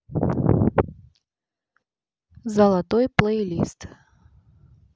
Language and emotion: Russian, neutral